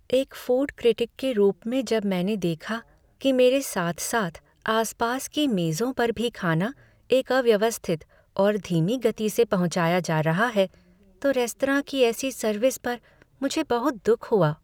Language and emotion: Hindi, sad